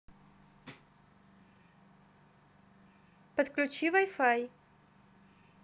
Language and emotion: Russian, neutral